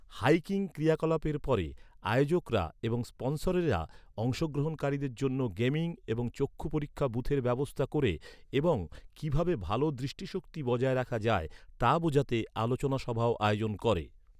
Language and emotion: Bengali, neutral